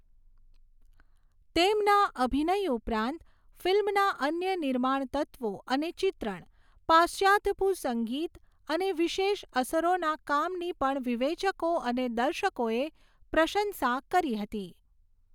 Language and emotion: Gujarati, neutral